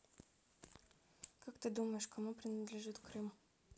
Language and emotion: Russian, neutral